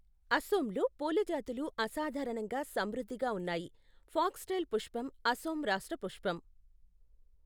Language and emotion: Telugu, neutral